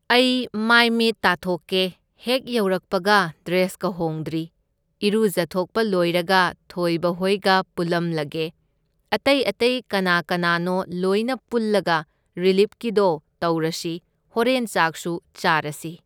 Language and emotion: Manipuri, neutral